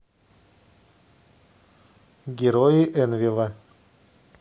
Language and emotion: Russian, neutral